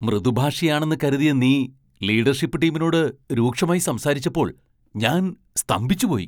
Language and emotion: Malayalam, surprised